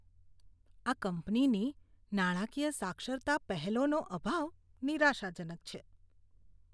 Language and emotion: Gujarati, disgusted